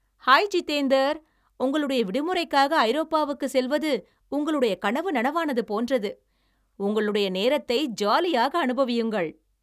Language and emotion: Tamil, happy